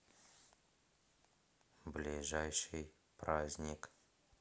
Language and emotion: Russian, neutral